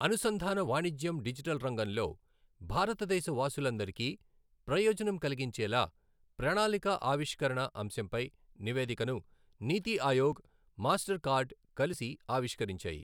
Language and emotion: Telugu, neutral